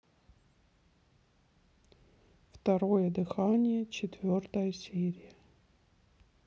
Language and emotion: Russian, neutral